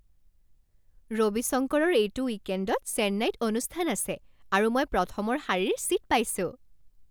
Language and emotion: Assamese, happy